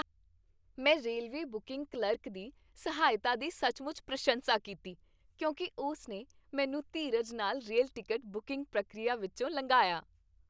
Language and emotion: Punjabi, happy